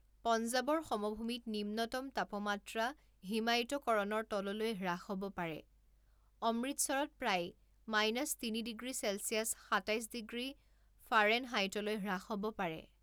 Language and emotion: Assamese, neutral